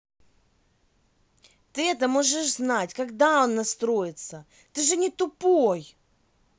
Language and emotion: Russian, angry